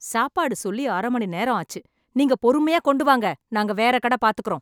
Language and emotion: Tamil, angry